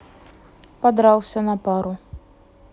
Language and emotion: Russian, neutral